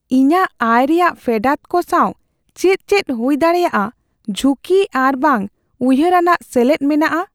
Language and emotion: Santali, fearful